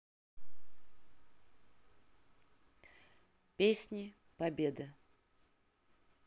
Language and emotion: Russian, neutral